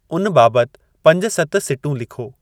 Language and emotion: Sindhi, neutral